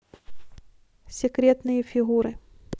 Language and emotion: Russian, neutral